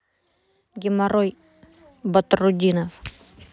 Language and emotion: Russian, neutral